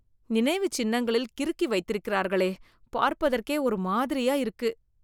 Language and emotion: Tamil, disgusted